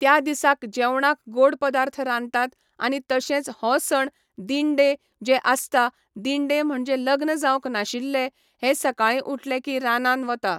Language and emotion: Goan Konkani, neutral